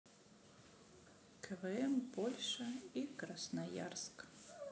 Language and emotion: Russian, neutral